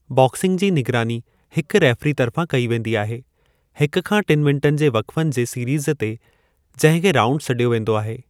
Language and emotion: Sindhi, neutral